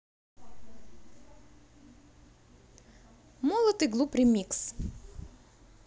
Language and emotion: Russian, positive